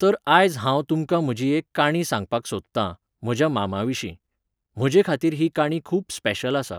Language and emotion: Goan Konkani, neutral